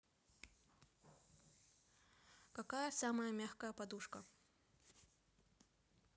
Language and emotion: Russian, neutral